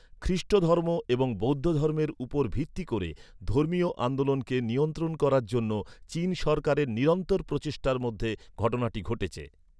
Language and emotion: Bengali, neutral